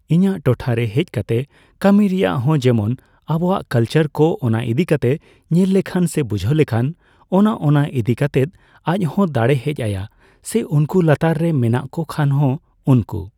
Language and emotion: Santali, neutral